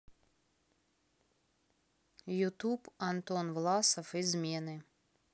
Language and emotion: Russian, neutral